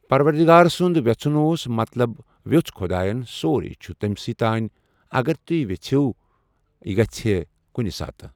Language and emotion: Kashmiri, neutral